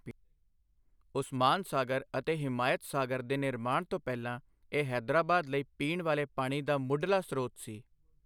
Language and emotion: Punjabi, neutral